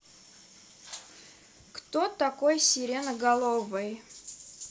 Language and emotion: Russian, neutral